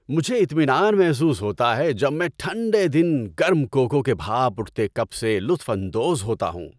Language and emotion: Urdu, happy